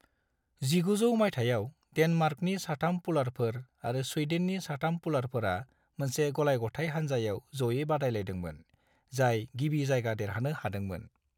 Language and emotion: Bodo, neutral